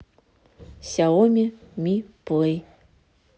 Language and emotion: Russian, neutral